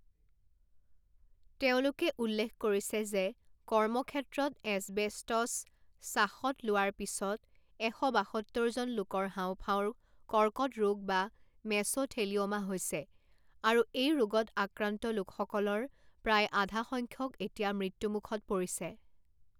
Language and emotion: Assamese, neutral